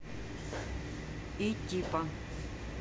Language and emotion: Russian, neutral